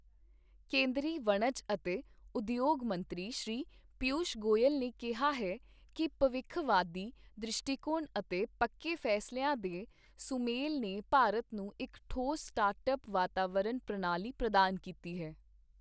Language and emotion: Punjabi, neutral